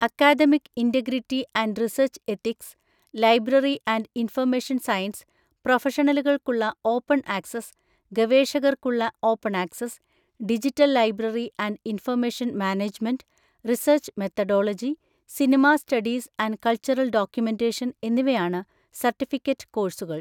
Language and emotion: Malayalam, neutral